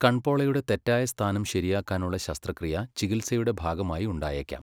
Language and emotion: Malayalam, neutral